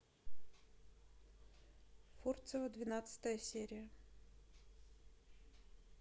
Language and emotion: Russian, neutral